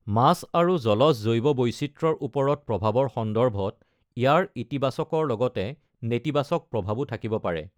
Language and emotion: Assamese, neutral